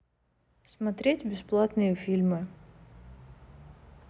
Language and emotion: Russian, neutral